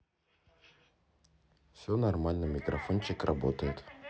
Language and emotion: Russian, neutral